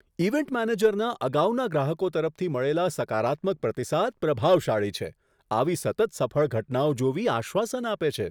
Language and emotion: Gujarati, surprised